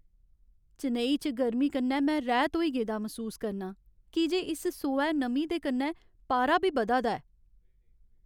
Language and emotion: Dogri, sad